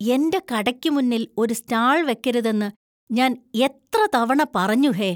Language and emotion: Malayalam, disgusted